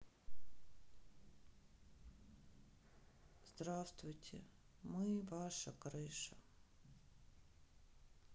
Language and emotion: Russian, sad